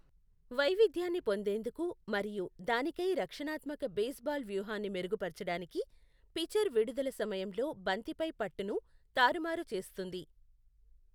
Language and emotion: Telugu, neutral